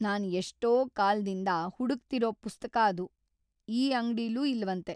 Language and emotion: Kannada, sad